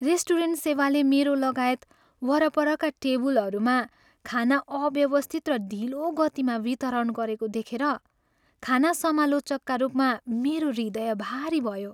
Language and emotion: Nepali, sad